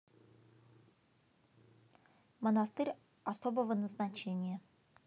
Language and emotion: Russian, neutral